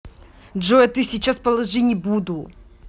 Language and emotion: Russian, angry